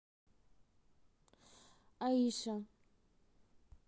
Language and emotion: Russian, neutral